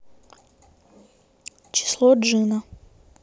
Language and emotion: Russian, neutral